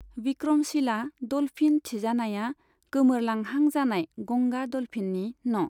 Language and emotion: Bodo, neutral